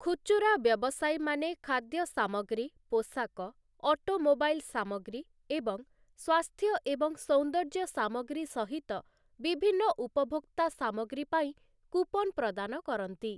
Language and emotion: Odia, neutral